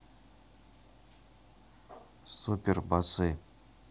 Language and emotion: Russian, neutral